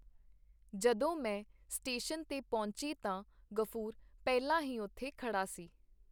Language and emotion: Punjabi, neutral